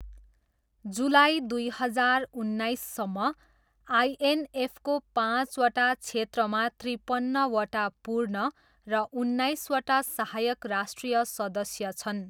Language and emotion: Nepali, neutral